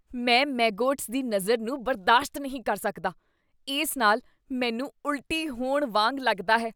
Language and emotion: Punjabi, disgusted